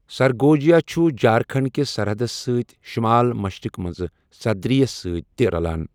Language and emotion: Kashmiri, neutral